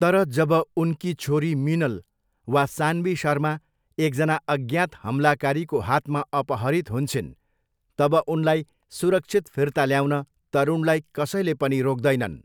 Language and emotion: Nepali, neutral